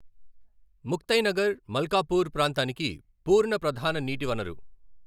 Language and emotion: Telugu, neutral